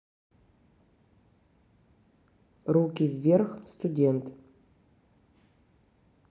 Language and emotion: Russian, neutral